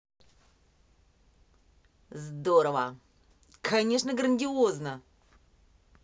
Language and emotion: Russian, positive